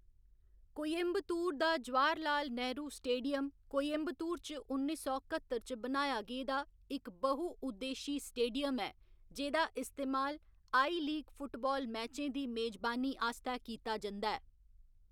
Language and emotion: Dogri, neutral